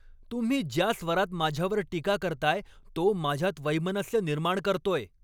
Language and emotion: Marathi, angry